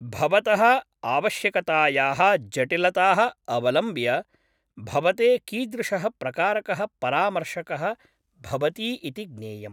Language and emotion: Sanskrit, neutral